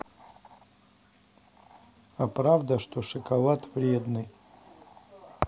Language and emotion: Russian, neutral